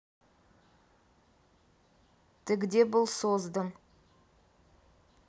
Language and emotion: Russian, neutral